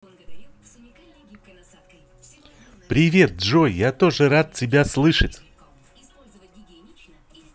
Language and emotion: Russian, positive